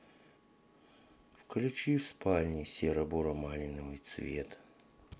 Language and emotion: Russian, sad